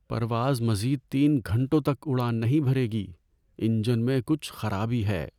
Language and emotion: Urdu, sad